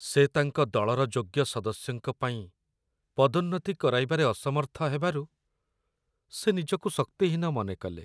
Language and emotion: Odia, sad